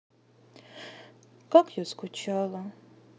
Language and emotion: Russian, sad